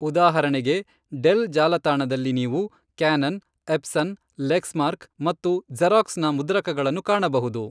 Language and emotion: Kannada, neutral